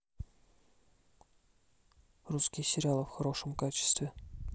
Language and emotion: Russian, neutral